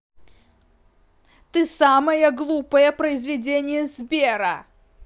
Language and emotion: Russian, angry